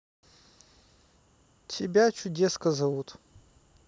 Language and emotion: Russian, neutral